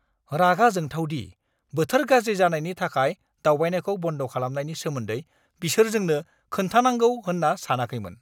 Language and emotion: Bodo, angry